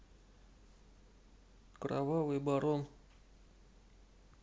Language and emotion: Russian, neutral